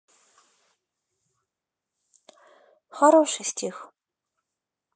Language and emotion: Russian, sad